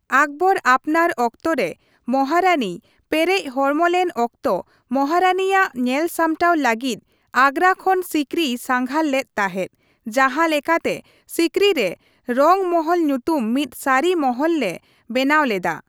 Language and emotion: Santali, neutral